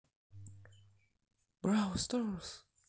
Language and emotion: Russian, positive